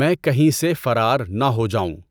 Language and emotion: Urdu, neutral